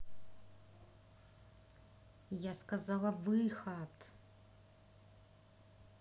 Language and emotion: Russian, angry